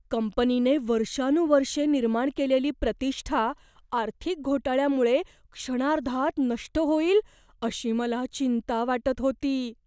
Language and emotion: Marathi, fearful